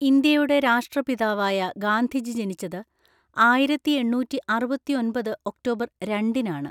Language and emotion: Malayalam, neutral